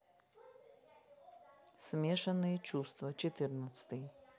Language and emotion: Russian, neutral